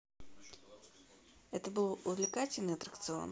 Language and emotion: Russian, neutral